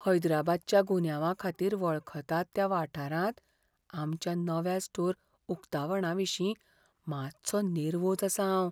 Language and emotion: Goan Konkani, fearful